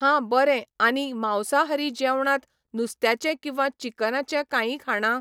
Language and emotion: Goan Konkani, neutral